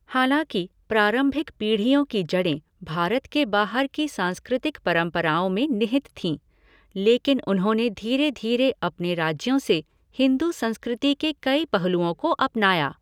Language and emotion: Hindi, neutral